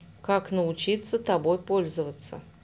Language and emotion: Russian, neutral